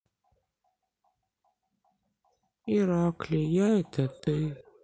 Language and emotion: Russian, sad